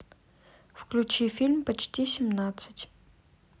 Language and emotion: Russian, neutral